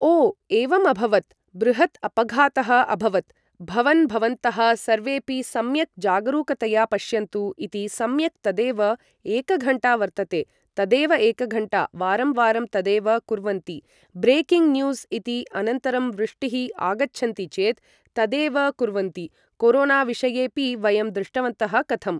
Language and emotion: Sanskrit, neutral